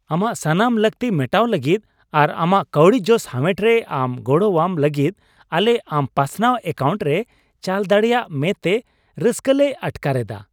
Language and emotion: Santali, happy